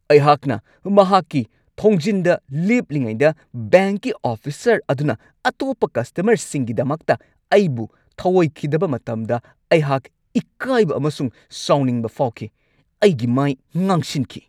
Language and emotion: Manipuri, angry